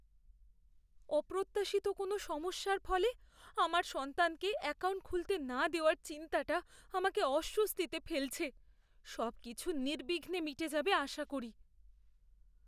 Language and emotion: Bengali, fearful